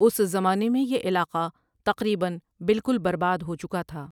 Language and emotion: Urdu, neutral